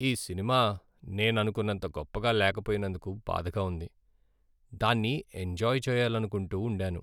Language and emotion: Telugu, sad